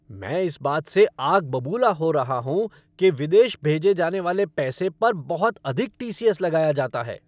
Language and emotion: Hindi, angry